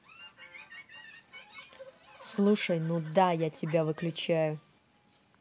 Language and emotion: Russian, angry